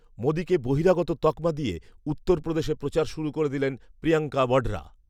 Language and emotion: Bengali, neutral